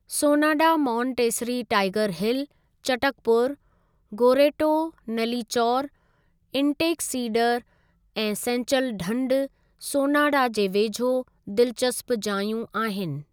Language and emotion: Sindhi, neutral